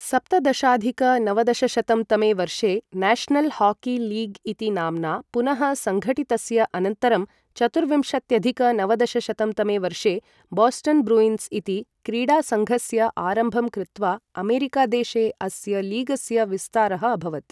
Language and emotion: Sanskrit, neutral